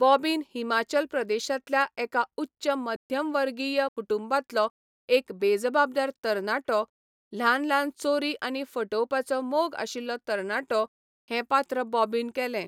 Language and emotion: Goan Konkani, neutral